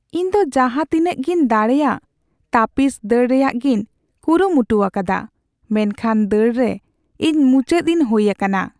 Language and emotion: Santali, sad